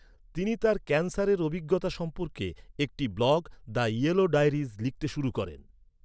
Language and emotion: Bengali, neutral